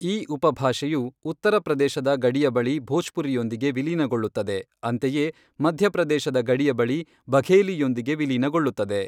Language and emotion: Kannada, neutral